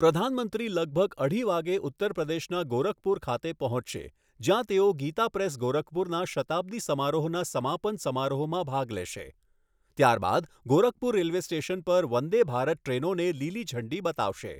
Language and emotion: Gujarati, neutral